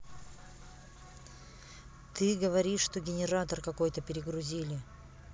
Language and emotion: Russian, neutral